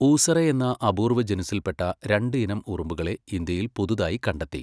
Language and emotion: Malayalam, neutral